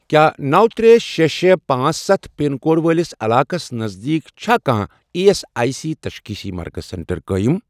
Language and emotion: Kashmiri, neutral